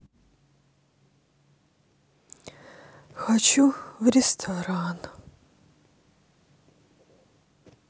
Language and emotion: Russian, sad